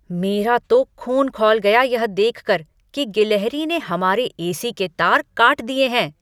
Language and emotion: Hindi, angry